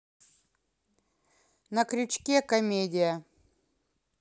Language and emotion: Russian, neutral